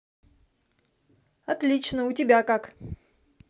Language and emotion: Russian, positive